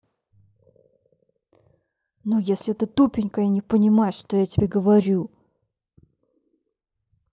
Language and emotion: Russian, angry